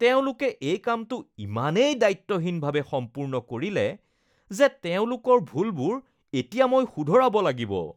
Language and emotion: Assamese, disgusted